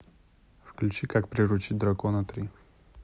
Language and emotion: Russian, neutral